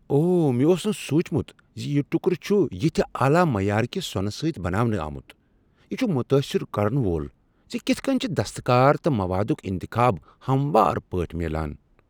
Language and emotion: Kashmiri, surprised